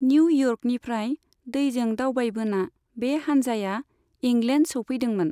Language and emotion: Bodo, neutral